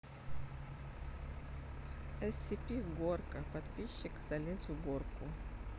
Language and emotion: Russian, neutral